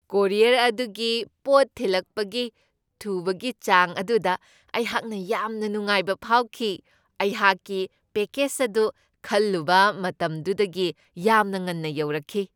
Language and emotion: Manipuri, happy